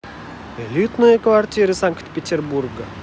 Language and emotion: Russian, positive